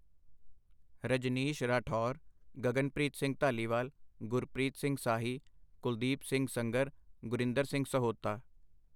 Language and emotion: Punjabi, neutral